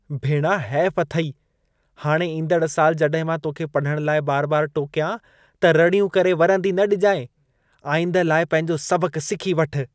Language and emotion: Sindhi, disgusted